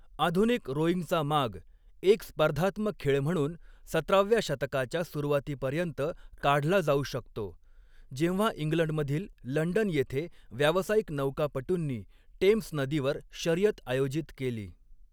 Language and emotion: Marathi, neutral